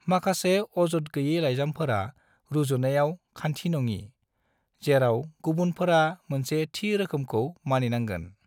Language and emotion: Bodo, neutral